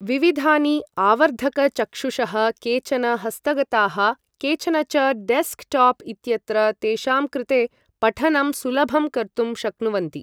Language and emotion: Sanskrit, neutral